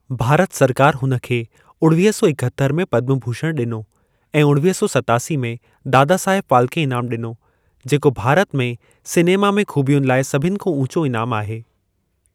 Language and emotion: Sindhi, neutral